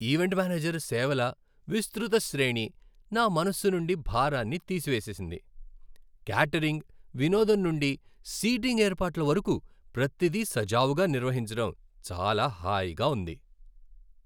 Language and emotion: Telugu, happy